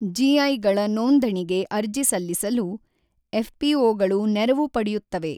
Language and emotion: Kannada, neutral